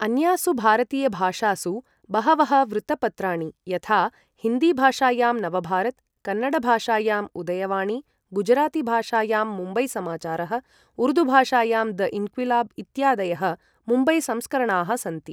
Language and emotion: Sanskrit, neutral